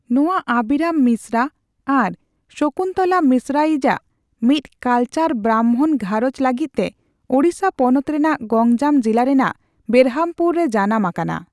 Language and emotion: Santali, neutral